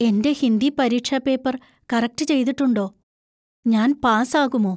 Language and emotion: Malayalam, fearful